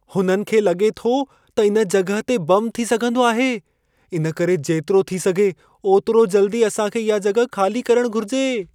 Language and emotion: Sindhi, fearful